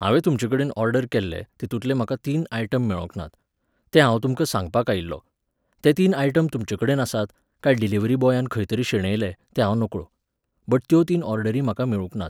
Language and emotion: Goan Konkani, neutral